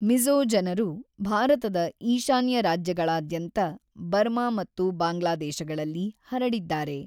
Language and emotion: Kannada, neutral